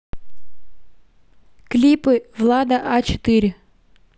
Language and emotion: Russian, neutral